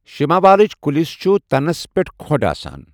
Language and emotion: Kashmiri, neutral